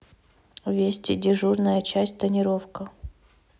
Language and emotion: Russian, neutral